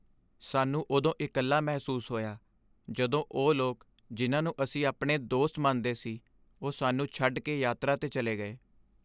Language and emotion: Punjabi, sad